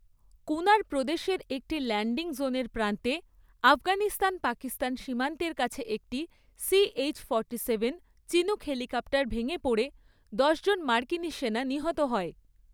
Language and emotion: Bengali, neutral